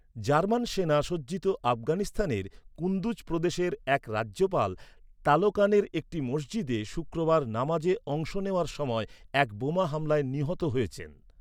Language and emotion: Bengali, neutral